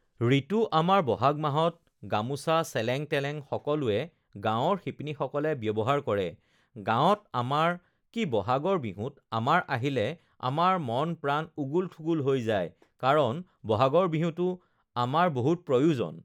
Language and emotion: Assamese, neutral